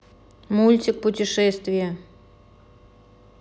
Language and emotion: Russian, neutral